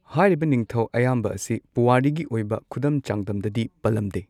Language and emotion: Manipuri, neutral